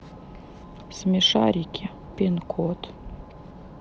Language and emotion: Russian, sad